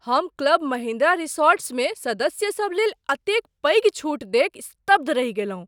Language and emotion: Maithili, surprised